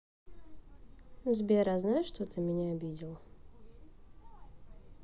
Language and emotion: Russian, sad